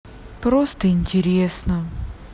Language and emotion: Russian, sad